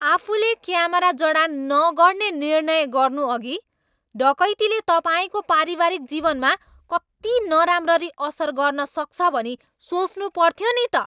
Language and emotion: Nepali, angry